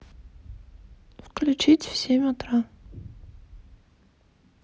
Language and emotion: Russian, neutral